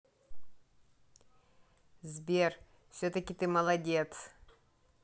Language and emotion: Russian, positive